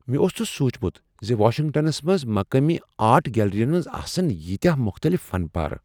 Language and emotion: Kashmiri, surprised